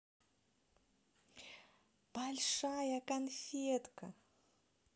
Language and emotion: Russian, positive